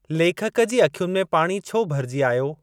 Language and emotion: Sindhi, neutral